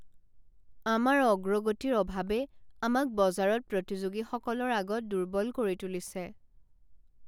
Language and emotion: Assamese, sad